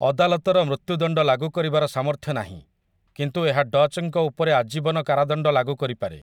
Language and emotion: Odia, neutral